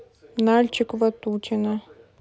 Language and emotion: Russian, neutral